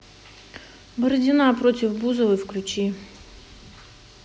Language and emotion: Russian, neutral